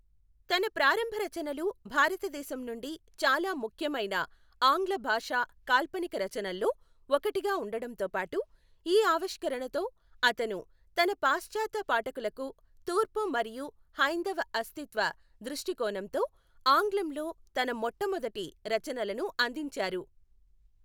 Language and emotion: Telugu, neutral